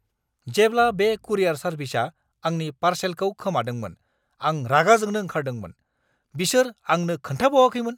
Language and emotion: Bodo, angry